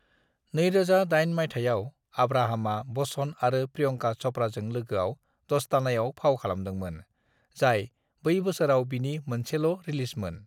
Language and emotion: Bodo, neutral